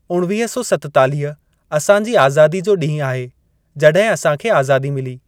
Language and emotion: Sindhi, neutral